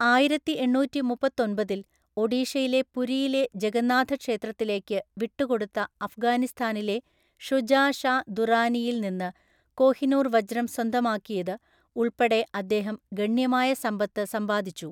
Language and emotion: Malayalam, neutral